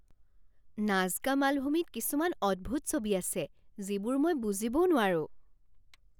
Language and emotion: Assamese, surprised